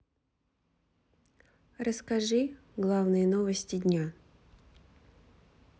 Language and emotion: Russian, neutral